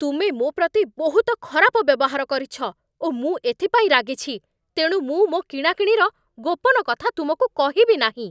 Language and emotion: Odia, angry